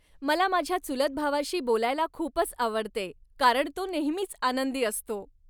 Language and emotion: Marathi, happy